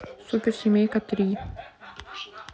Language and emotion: Russian, neutral